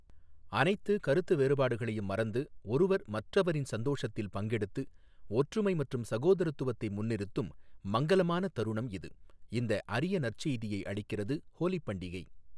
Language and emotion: Tamil, neutral